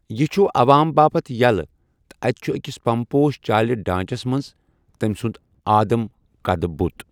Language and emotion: Kashmiri, neutral